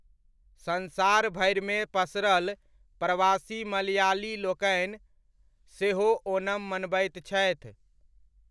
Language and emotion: Maithili, neutral